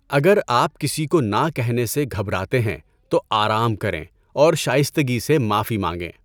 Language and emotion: Urdu, neutral